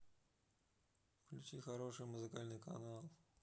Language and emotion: Russian, neutral